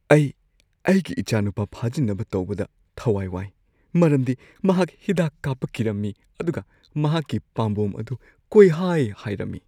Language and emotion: Manipuri, fearful